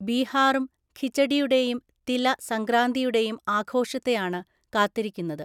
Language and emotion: Malayalam, neutral